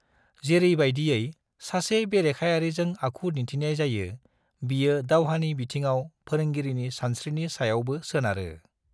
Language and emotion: Bodo, neutral